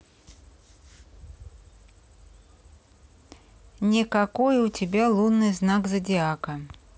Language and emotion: Russian, neutral